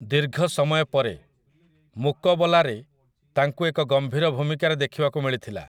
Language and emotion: Odia, neutral